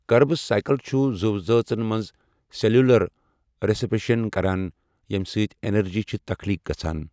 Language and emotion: Kashmiri, neutral